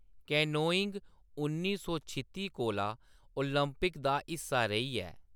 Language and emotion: Dogri, neutral